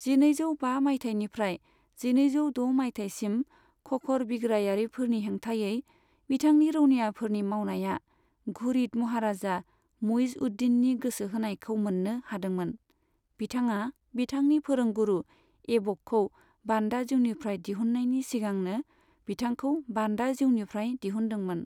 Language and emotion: Bodo, neutral